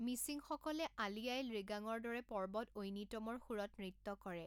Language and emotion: Assamese, neutral